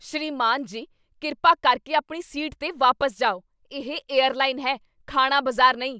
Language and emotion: Punjabi, angry